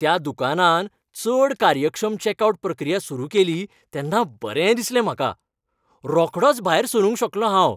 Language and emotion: Goan Konkani, happy